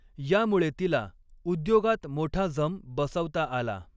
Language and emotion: Marathi, neutral